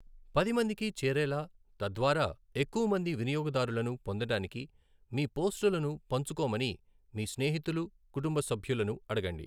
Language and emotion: Telugu, neutral